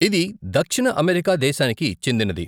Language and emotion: Telugu, neutral